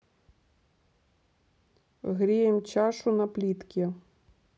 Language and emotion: Russian, neutral